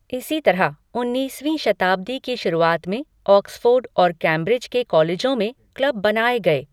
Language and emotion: Hindi, neutral